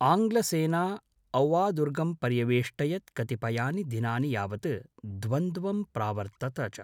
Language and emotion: Sanskrit, neutral